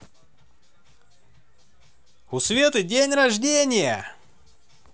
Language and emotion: Russian, positive